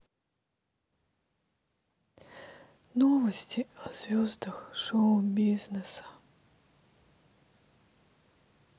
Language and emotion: Russian, sad